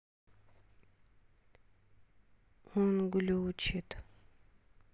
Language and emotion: Russian, sad